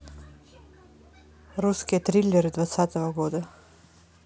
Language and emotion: Russian, neutral